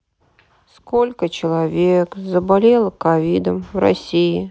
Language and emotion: Russian, sad